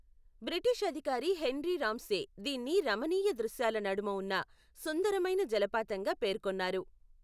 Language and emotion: Telugu, neutral